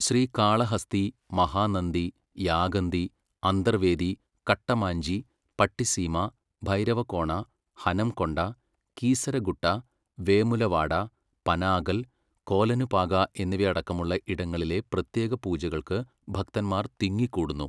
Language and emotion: Malayalam, neutral